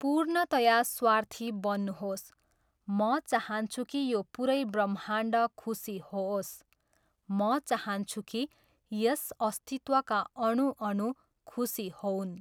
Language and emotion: Nepali, neutral